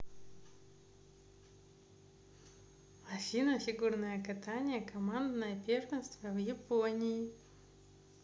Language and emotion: Russian, positive